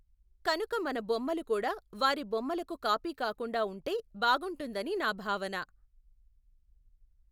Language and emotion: Telugu, neutral